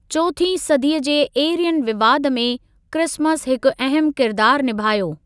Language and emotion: Sindhi, neutral